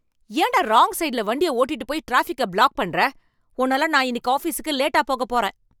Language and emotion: Tamil, angry